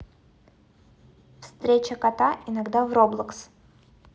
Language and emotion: Russian, neutral